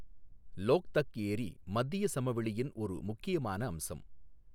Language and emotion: Tamil, neutral